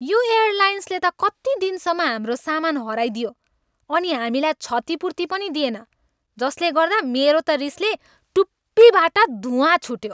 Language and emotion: Nepali, angry